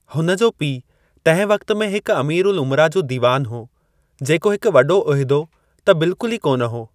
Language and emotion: Sindhi, neutral